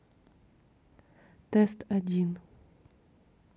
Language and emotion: Russian, neutral